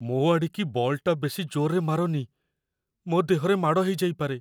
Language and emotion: Odia, fearful